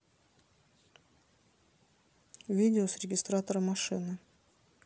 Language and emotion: Russian, neutral